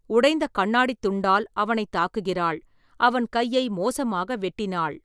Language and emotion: Tamil, neutral